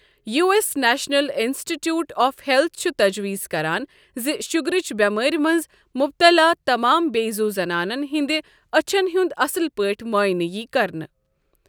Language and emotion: Kashmiri, neutral